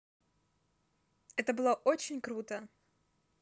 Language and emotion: Russian, positive